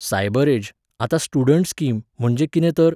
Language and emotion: Goan Konkani, neutral